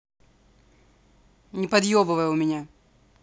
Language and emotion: Russian, angry